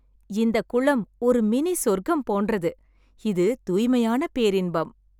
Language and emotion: Tamil, happy